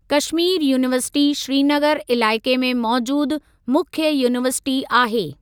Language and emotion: Sindhi, neutral